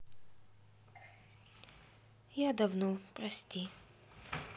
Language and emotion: Russian, sad